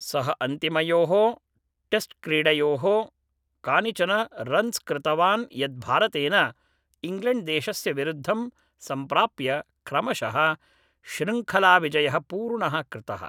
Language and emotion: Sanskrit, neutral